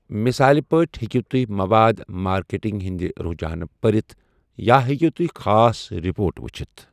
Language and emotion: Kashmiri, neutral